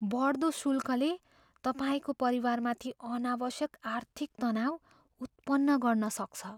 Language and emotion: Nepali, fearful